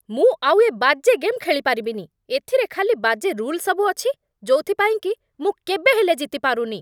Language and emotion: Odia, angry